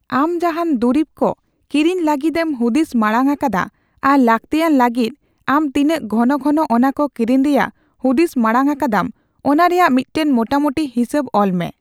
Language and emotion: Santali, neutral